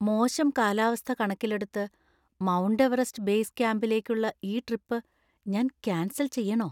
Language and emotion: Malayalam, fearful